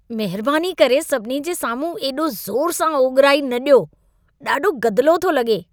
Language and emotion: Sindhi, disgusted